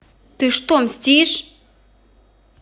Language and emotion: Russian, angry